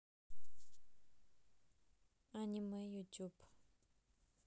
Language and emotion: Russian, neutral